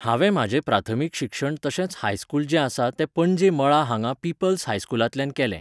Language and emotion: Goan Konkani, neutral